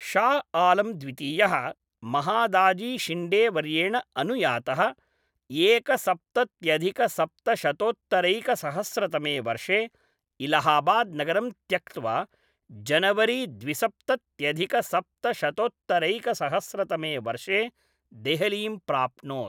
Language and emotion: Sanskrit, neutral